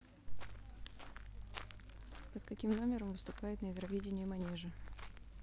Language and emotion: Russian, neutral